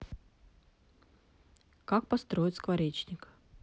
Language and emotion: Russian, neutral